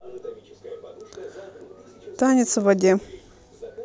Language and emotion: Russian, neutral